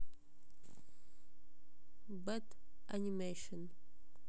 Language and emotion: Russian, neutral